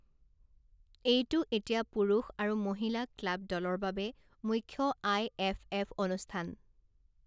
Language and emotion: Assamese, neutral